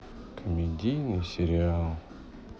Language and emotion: Russian, sad